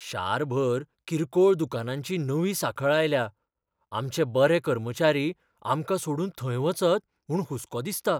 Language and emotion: Goan Konkani, fearful